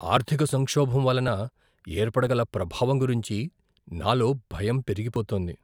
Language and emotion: Telugu, fearful